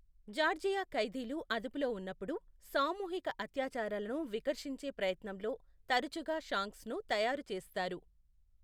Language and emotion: Telugu, neutral